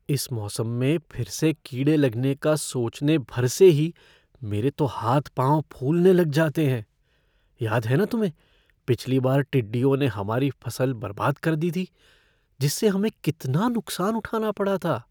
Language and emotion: Hindi, fearful